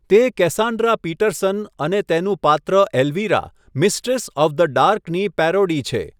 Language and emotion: Gujarati, neutral